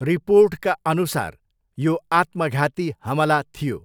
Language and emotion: Nepali, neutral